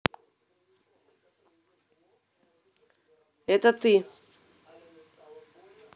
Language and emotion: Russian, angry